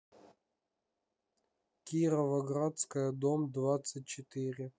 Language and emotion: Russian, neutral